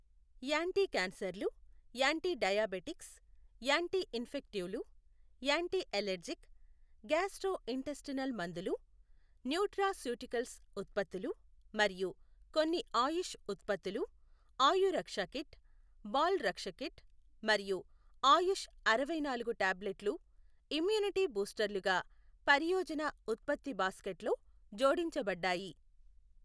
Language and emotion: Telugu, neutral